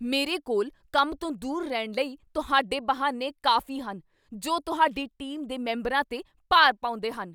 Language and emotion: Punjabi, angry